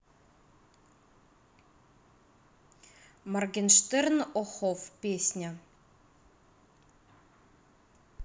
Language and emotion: Russian, neutral